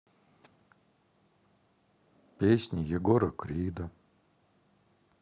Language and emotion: Russian, sad